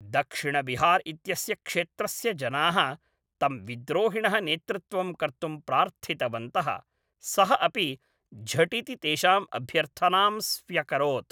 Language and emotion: Sanskrit, neutral